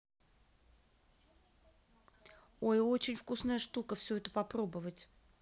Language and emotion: Russian, neutral